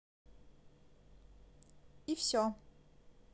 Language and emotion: Russian, neutral